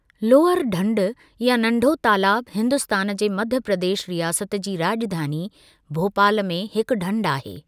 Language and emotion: Sindhi, neutral